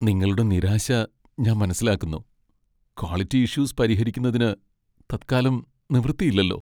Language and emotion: Malayalam, sad